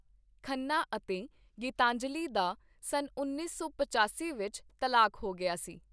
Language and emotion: Punjabi, neutral